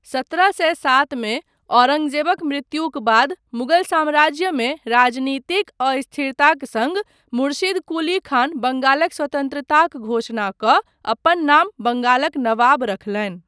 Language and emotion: Maithili, neutral